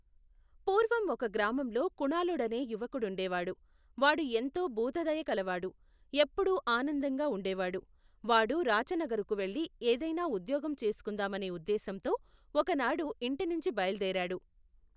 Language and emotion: Telugu, neutral